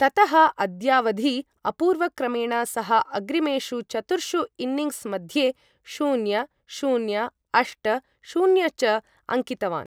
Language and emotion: Sanskrit, neutral